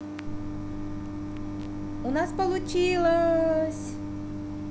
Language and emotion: Russian, positive